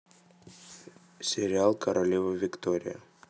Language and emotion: Russian, neutral